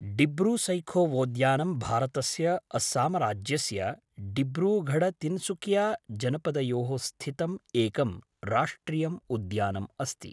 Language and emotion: Sanskrit, neutral